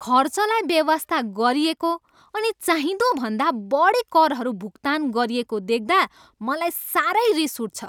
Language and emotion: Nepali, angry